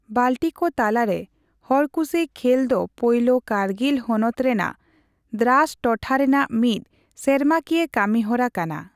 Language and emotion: Santali, neutral